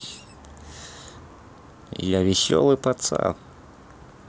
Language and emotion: Russian, neutral